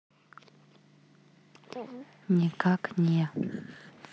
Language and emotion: Russian, neutral